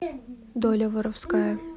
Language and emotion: Russian, neutral